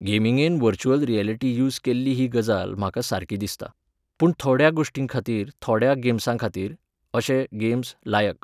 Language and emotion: Goan Konkani, neutral